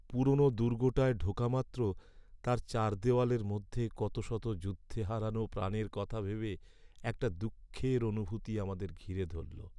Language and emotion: Bengali, sad